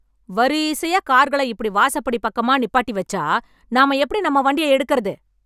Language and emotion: Tamil, angry